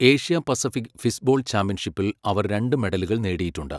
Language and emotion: Malayalam, neutral